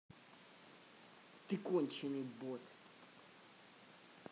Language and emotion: Russian, angry